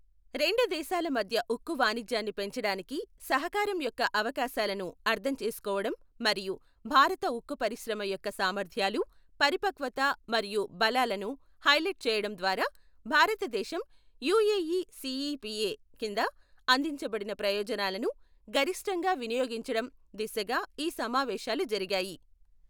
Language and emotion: Telugu, neutral